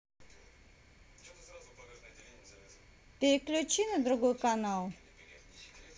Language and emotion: Russian, neutral